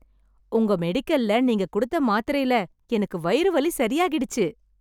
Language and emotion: Tamil, happy